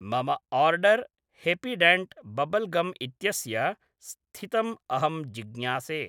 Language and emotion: Sanskrit, neutral